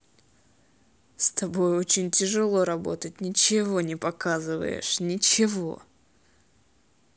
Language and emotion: Russian, angry